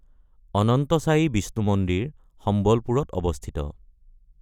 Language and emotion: Assamese, neutral